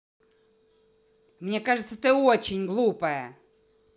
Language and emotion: Russian, angry